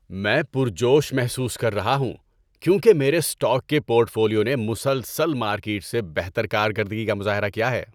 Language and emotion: Urdu, happy